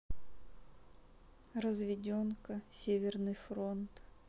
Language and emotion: Russian, sad